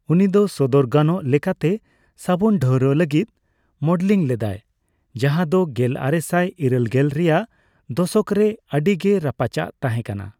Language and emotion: Santali, neutral